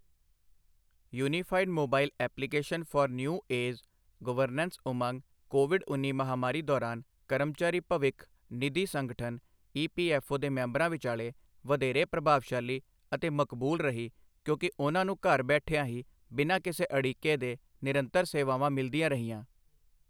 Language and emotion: Punjabi, neutral